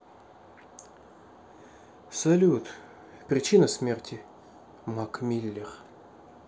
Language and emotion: Russian, neutral